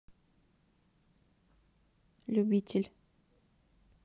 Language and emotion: Russian, neutral